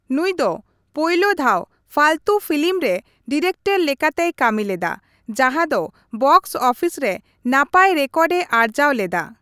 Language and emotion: Santali, neutral